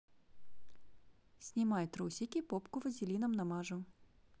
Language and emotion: Russian, neutral